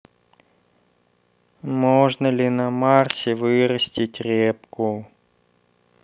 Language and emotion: Russian, sad